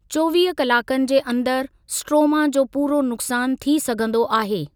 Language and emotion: Sindhi, neutral